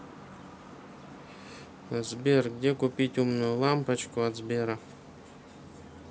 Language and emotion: Russian, neutral